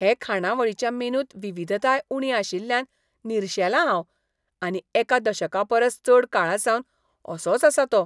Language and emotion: Goan Konkani, disgusted